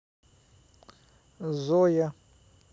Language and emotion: Russian, neutral